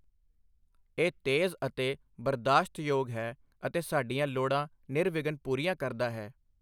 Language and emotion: Punjabi, neutral